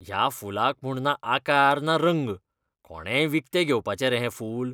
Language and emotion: Goan Konkani, disgusted